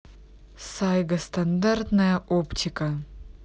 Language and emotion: Russian, neutral